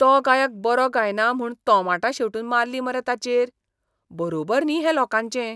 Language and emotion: Goan Konkani, disgusted